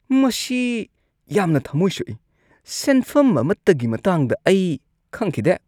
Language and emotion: Manipuri, disgusted